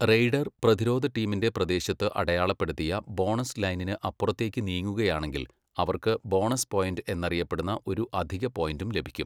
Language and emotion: Malayalam, neutral